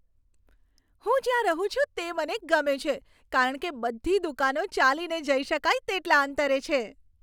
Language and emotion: Gujarati, happy